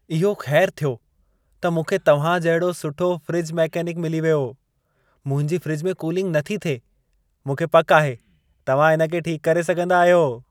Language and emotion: Sindhi, happy